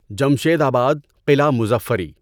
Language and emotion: Urdu, neutral